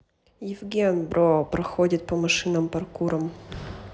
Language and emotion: Russian, neutral